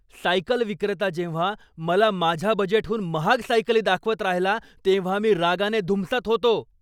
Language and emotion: Marathi, angry